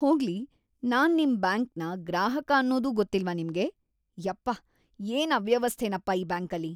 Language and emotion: Kannada, disgusted